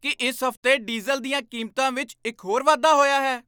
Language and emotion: Punjabi, surprised